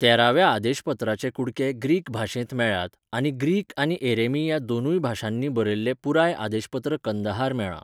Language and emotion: Goan Konkani, neutral